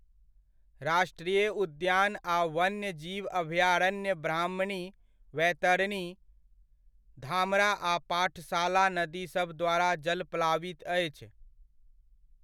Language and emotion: Maithili, neutral